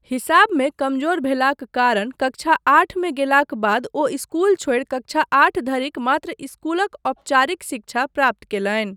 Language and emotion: Maithili, neutral